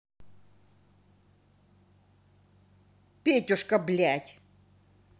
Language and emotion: Russian, angry